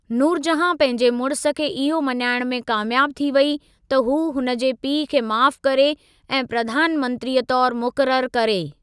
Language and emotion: Sindhi, neutral